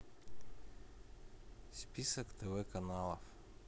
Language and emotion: Russian, neutral